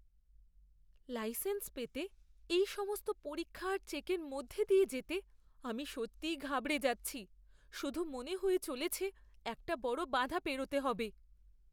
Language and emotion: Bengali, fearful